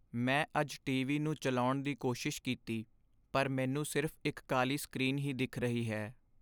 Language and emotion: Punjabi, sad